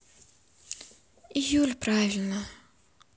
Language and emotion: Russian, sad